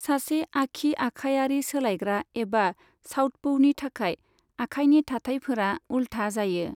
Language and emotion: Bodo, neutral